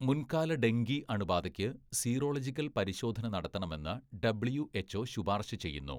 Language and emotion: Malayalam, neutral